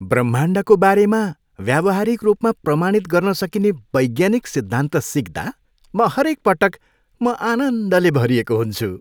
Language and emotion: Nepali, happy